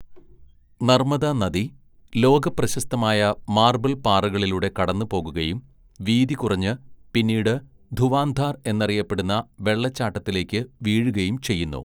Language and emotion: Malayalam, neutral